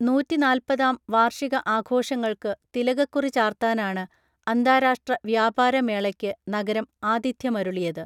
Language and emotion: Malayalam, neutral